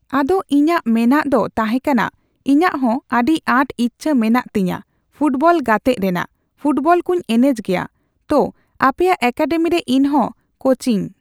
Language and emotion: Santali, neutral